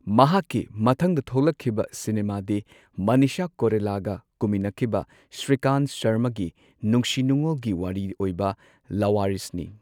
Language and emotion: Manipuri, neutral